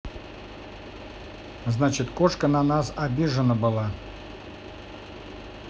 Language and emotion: Russian, neutral